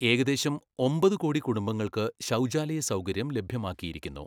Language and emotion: Malayalam, neutral